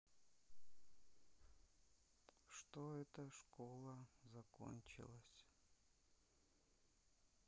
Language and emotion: Russian, sad